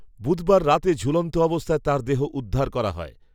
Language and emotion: Bengali, neutral